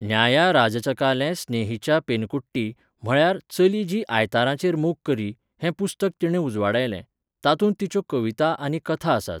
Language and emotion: Goan Konkani, neutral